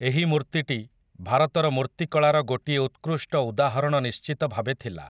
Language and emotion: Odia, neutral